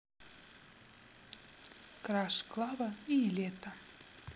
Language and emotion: Russian, neutral